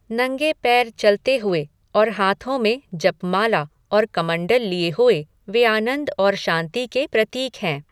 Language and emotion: Hindi, neutral